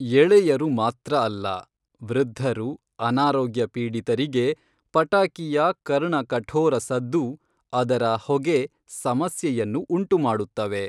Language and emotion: Kannada, neutral